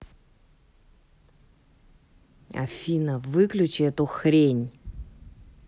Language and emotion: Russian, angry